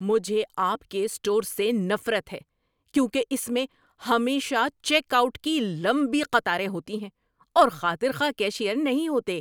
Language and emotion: Urdu, angry